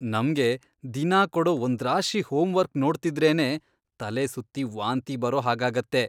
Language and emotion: Kannada, disgusted